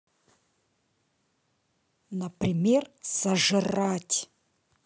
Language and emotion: Russian, neutral